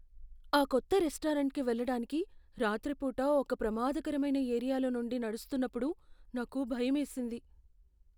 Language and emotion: Telugu, fearful